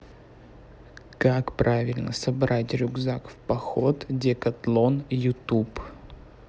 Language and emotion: Russian, neutral